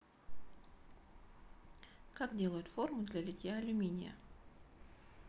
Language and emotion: Russian, neutral